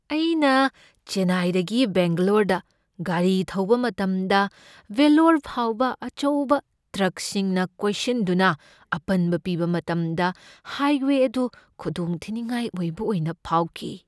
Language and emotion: Manipuri, fearful